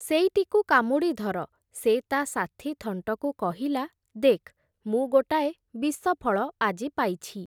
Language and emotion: Odia, neutral